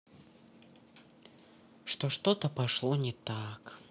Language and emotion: Russian, neutral